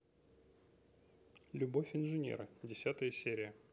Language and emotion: Russian, neutral